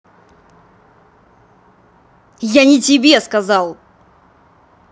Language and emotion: Russian, angry